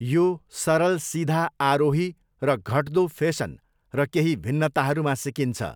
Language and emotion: Nepali, neutral